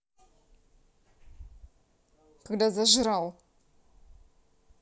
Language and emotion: Russian, angry